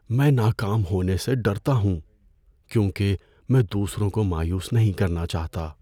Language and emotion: Urdu, fearful